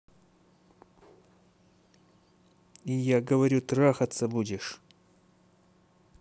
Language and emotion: Russian, angry